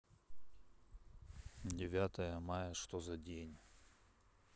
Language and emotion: Russian, neutral